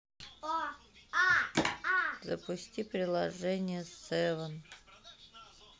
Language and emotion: Russian, neutral